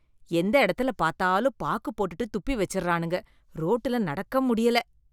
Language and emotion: Tamil, disgusted